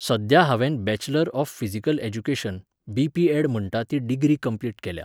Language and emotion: Goan Konkani, neutral